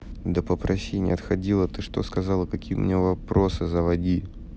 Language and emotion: Russian, neutral